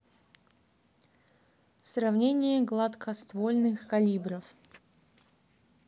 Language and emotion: Russian, neutral